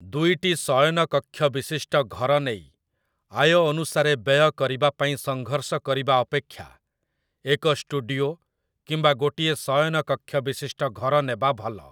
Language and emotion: Odia, neutral